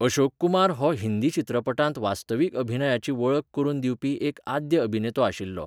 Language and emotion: Goan Konkani, neutral